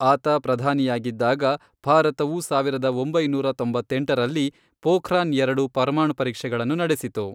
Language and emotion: Kannada, neutral